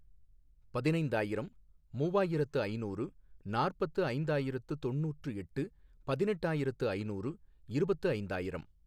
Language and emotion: Tamil, neutral